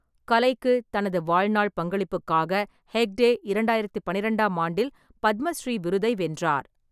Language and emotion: Tamil, neutral